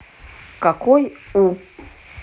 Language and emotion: Russian, neutral